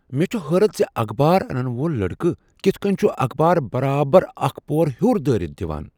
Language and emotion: Kashmiri, surprised